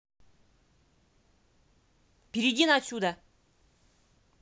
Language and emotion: Russian, angry